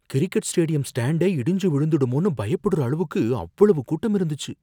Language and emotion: Tamil, fearful